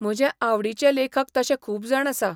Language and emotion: Goan Konkani, neutral